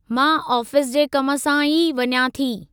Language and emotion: Sindhi, neutral